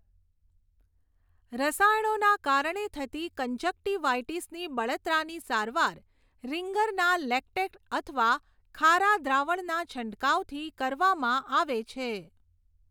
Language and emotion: Gujarati, neutral